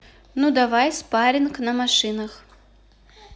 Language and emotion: Russian, neutral